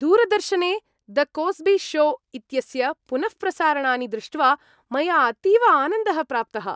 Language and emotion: Sanskrit, happy